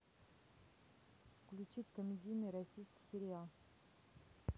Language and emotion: Russian, neutral